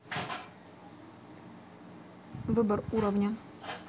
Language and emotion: Russian, neutral